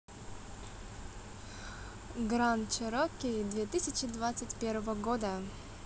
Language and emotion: Russian, positive